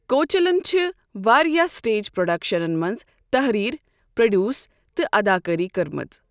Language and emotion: Kashmiri, neutral